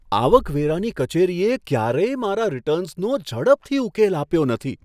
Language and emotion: Gujarati, surprised